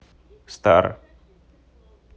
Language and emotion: Russian, neutral